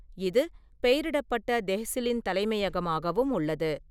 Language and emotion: Tamil, neutral